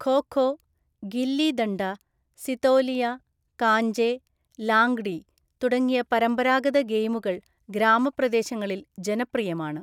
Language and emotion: Malayalam, neutral